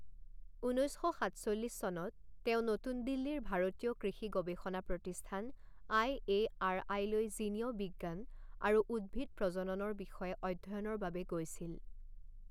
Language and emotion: Assamese, neutral